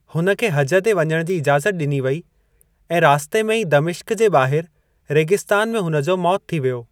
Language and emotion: Sindhi, neutral